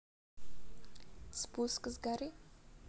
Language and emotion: Russian, neutral